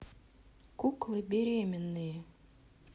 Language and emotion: Russian, neutral